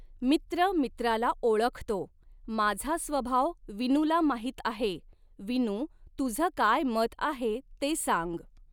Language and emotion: Marathi, neutral